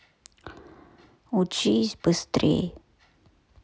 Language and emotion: Russian, sad